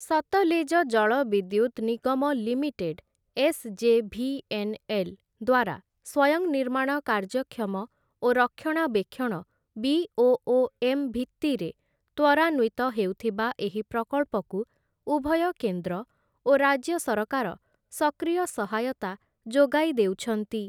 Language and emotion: Odia, neutral